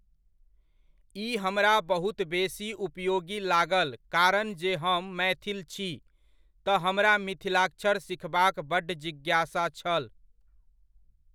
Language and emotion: Maithili, neutral